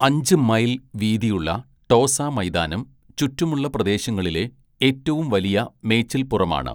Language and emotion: Malayalam, neutral